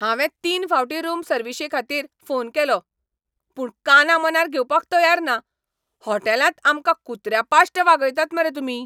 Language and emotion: Goan Konkani, angry